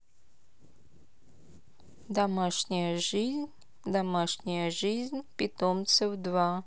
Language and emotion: Russian, neutral